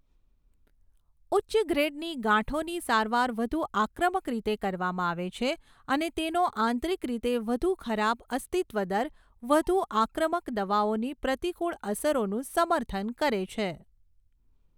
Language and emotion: Gujarati, neutral